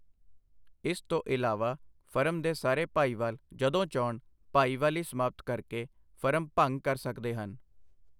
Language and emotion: Punjabi, neutral